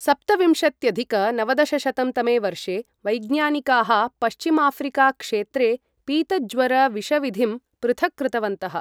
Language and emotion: Sanskrit, neutral